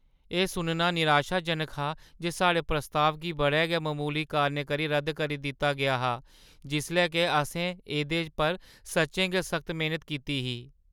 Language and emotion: Dogri, sad